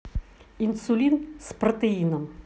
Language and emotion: Russian, neutral